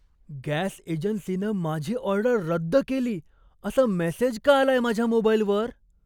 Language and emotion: Marathi, surprised